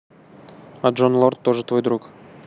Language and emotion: Russian, neutral